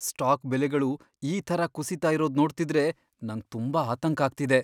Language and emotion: Kannada, fearful